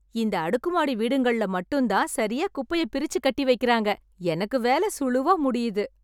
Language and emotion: Tamil, happy